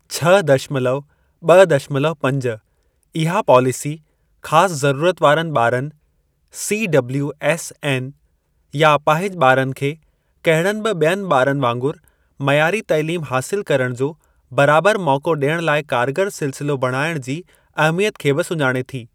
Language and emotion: Sindhi, neutral